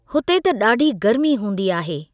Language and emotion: Sindhi, neutral